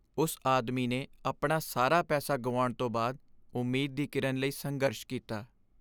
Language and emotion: Punjabi, sad